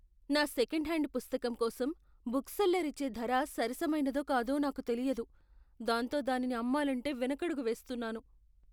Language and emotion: Telugu, fearful